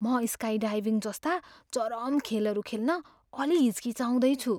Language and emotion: Nepali, fearful